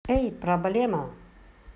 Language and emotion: Russian, positive